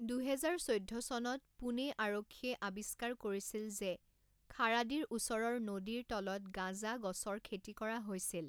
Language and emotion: Assamese, neutral